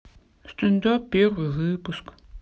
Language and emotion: Russian, sad